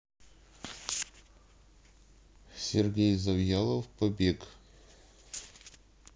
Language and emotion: Russian, neutral